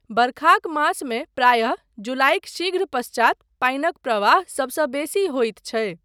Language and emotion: Maithili, neutral